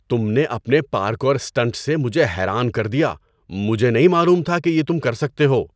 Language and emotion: Urdu, surprised